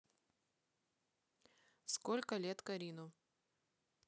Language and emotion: Russian, neutral